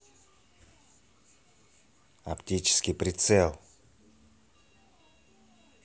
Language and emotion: Russian, angry